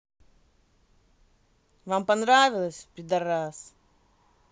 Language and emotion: Russian, angry